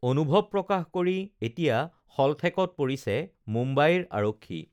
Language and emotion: Assamese, neutral